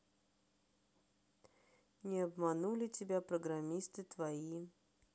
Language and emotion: Russian, neutral